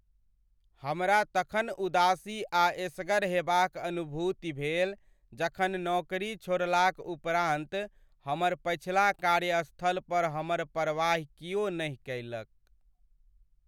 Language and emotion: Maithili, sad